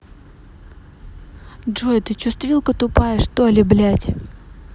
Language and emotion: Russian, angry